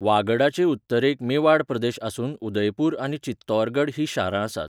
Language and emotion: Goan Konkani, neutral